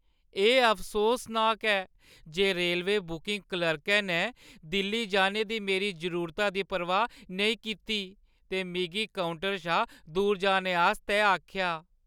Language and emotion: Dogri, sad